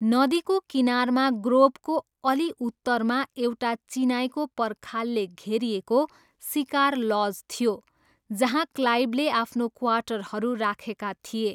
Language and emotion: Nepali, neutral